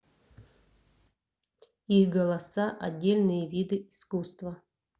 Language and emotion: Russian, neutral